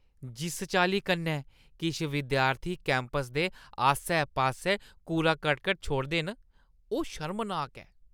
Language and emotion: Dogri, disgusted